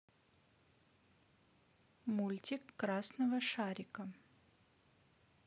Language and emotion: Russian, neutral